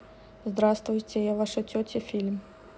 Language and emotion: Russian, neutral